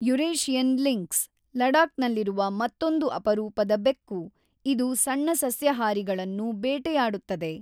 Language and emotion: Kannada, neutral